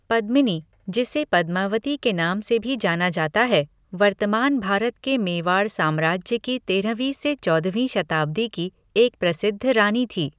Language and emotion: Hindi, neutral